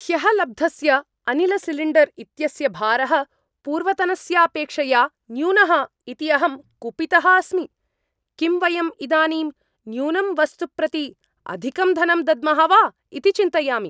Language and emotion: Sanskrit, angry